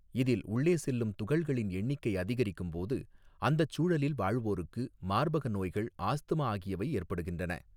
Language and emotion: Tamil, neutral